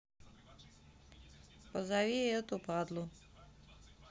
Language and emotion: Russian, neutral